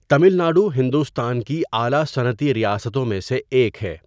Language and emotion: Urdu, neutral